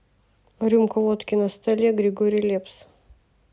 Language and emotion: Russian, neutral